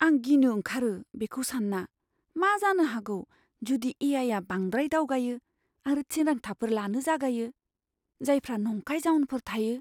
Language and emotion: Bodo, fearful